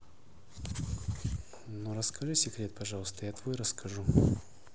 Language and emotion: Russian, neutral